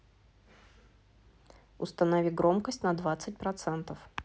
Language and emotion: Russian, neutral